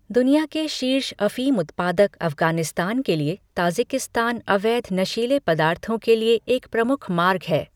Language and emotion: Hindi, neutral